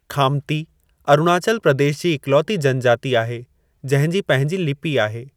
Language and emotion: Sindhi, neutral